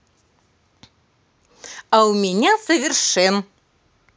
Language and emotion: Russian, positive